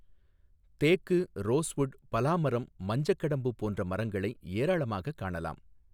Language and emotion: Tamil, neutral